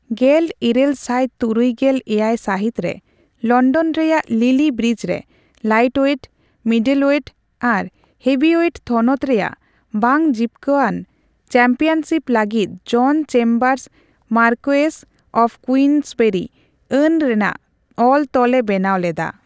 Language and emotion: Santali, neutral